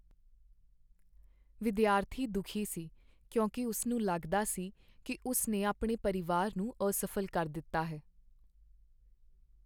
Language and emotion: Punjabi, sad